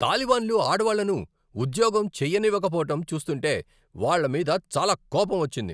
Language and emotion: Telugu, angry